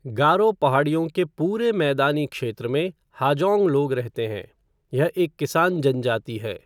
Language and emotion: Hindi, neutral